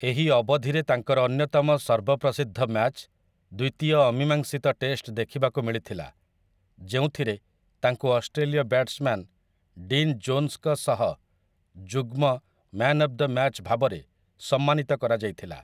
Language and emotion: Odia, neutral